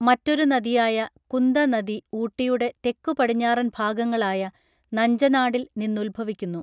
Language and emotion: Malayalam, neutral